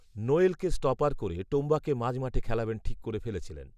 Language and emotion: Bengali, neutral